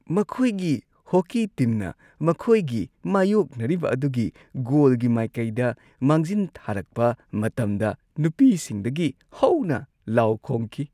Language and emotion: Manipuri, happy